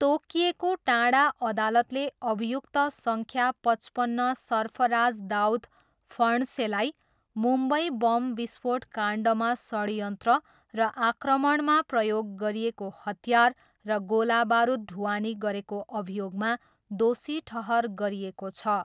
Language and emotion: Nepali, neutral